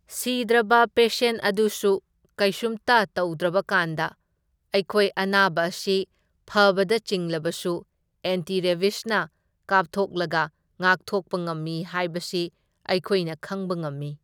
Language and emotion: Manipuri, neutral